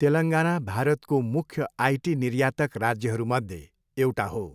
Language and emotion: Nepali, neutral